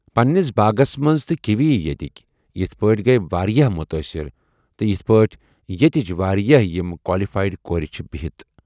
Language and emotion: Kashmiri, neutral